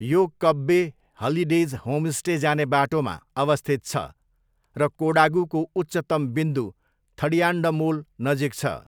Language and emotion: Nepali, neutral